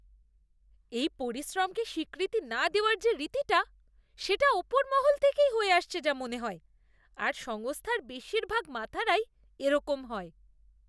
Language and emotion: Bengali, disgusted